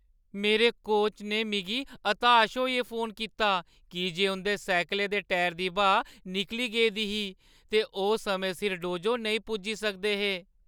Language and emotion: Dogri, sad